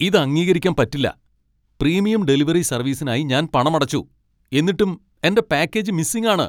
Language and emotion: Malayalam, angry